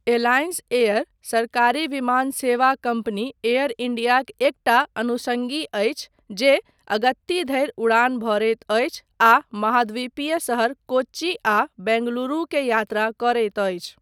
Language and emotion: Maithili, neutral